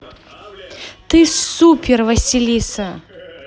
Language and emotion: Russian, positive